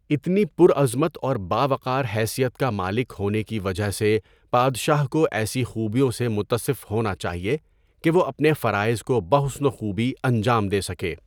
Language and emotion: Urdu, neutral